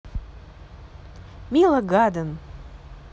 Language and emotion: Russian, positive